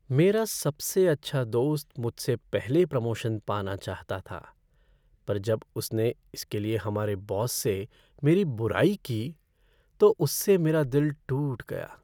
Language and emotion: Hindi, sad